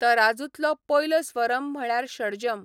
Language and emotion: Goan Konkani, neutral